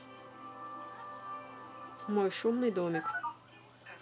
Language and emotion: Russian, neutral